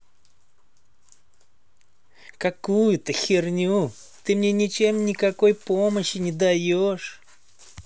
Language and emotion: Russian, angry